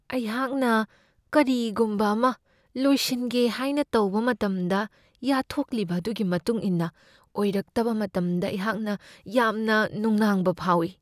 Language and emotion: Manipuri, fearful